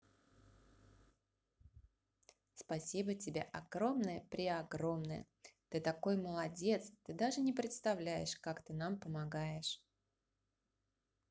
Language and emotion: Russian, positive